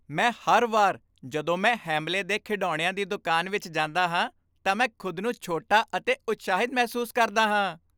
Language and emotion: Punjabi, happy